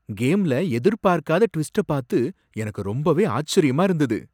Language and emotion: Tamil, surprised